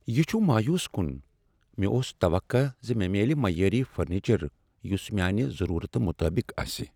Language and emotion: Kashmiri, sad